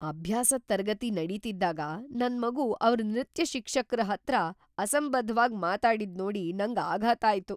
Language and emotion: Kannada, surprised